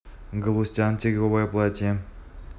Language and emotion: Russian, neutral